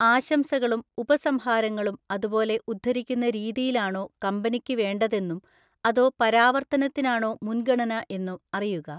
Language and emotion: Malayalam, neutral